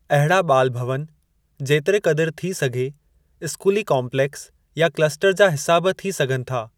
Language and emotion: Sindhi, neutral